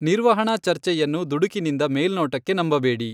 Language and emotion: Kannada, neutral